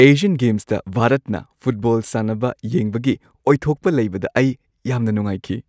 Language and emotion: Manipuri, happy